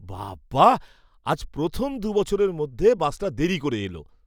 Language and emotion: Bengali, surprised